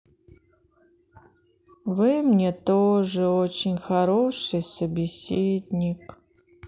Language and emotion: Russian, sad